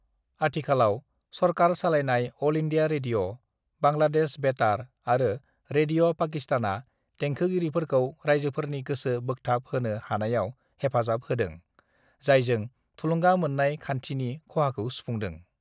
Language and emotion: Bodo, neutral